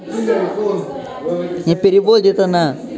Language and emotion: Russian, angry